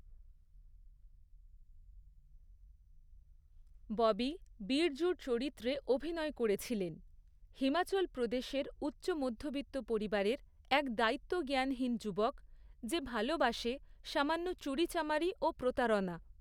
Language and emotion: Bengali, neutral